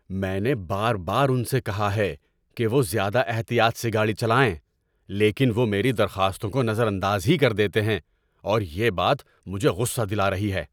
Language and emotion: Urdu, angry